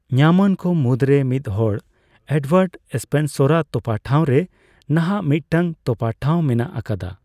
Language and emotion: Santali, neutral